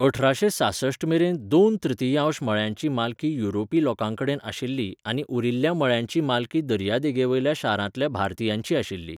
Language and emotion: Goan Konkani, neutral